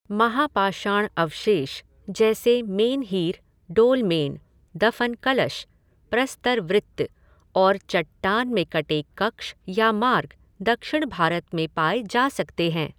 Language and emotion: Hindi, neutral